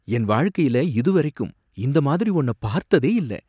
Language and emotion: Tamil, surprised